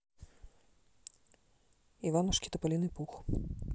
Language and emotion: Russian, neutral